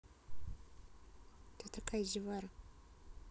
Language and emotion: Russian, neutral